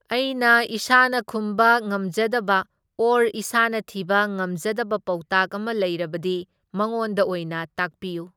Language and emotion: Manipuri, neutral